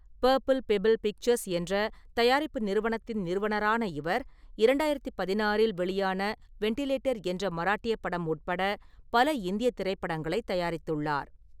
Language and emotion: Tamil, neutral